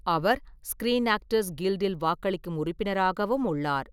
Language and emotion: Tamil, neutral